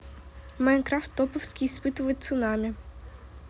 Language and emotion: Russian, neutral